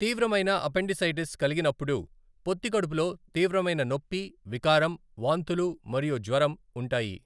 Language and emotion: Telugu, neutral